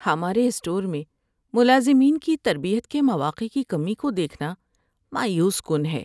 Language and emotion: Urdu, sad